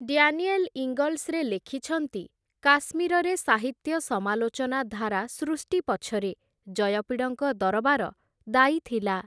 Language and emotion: Odia, neutral